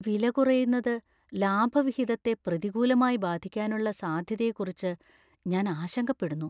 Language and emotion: Malayalam, fearful